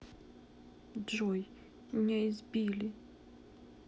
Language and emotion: Russian, sad